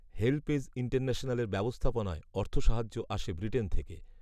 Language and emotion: Bengali, neutral